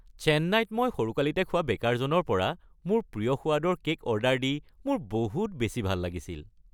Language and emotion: Assamese, happy